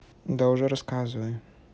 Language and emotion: Russian, neutral